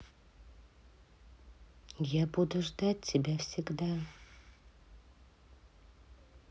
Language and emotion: Russian, neutral